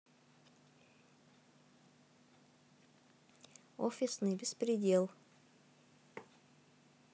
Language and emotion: Russian, neutral